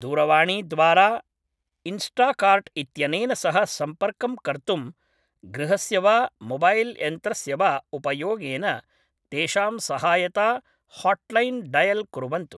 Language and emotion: Sanskrit, neutral